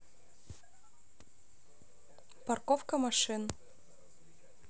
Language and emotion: Russian, neutral